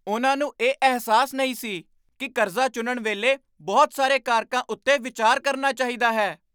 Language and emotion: Punjabi, surprised